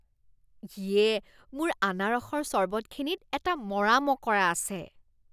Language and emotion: Assamese, disgusted